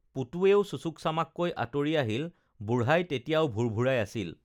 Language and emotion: Assamese, neutral